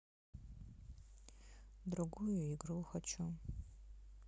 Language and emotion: Russian, sad